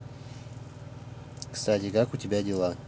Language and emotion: Russian, neutral